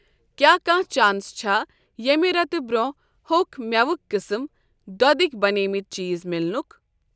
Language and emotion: Kashmiri, neutral